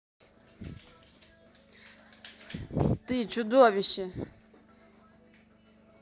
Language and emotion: Russian, angry